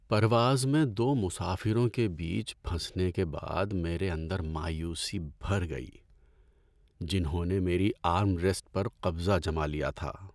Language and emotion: Urdu, sad